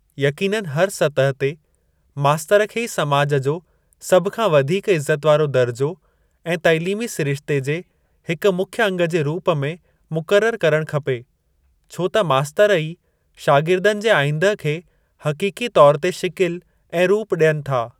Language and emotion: Sindhi, neutral